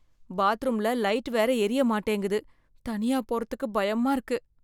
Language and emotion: Tamil, fearful